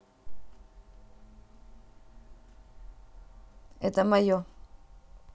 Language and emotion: Russian, neutral